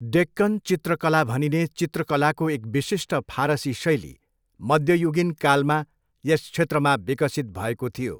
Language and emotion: Nepali, neutral